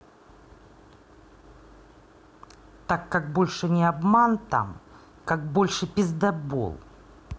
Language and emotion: Russian, angry